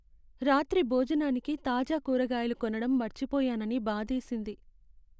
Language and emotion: Telugu, sad